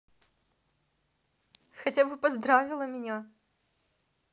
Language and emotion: Russian, positive